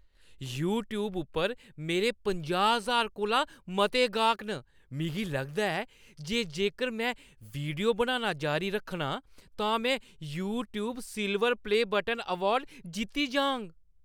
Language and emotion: Dogri, happy